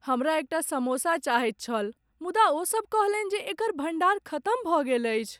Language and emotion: Maithili, sad